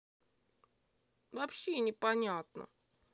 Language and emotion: Russian, sad